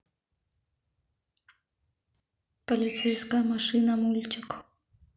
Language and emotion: Russian, neutral